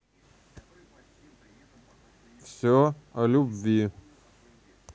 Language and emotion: Russian, neutral